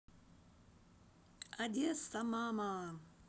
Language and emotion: Russian, neutral